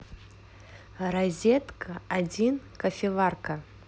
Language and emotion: Russian, neutral